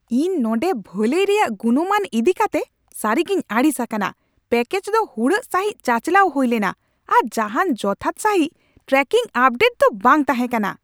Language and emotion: Santali, angry